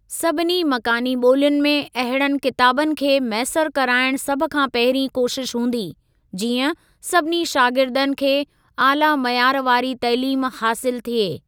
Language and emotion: Sindhi, neutral